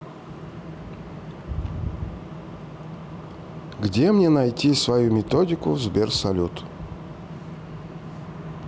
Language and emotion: Russian, neutral